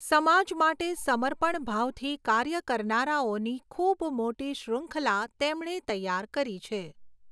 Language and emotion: Gujarati, neutral